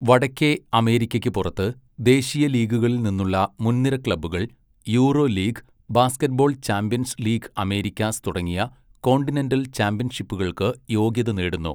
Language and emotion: Malayalam, neutral